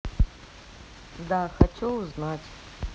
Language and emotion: Russian, neutral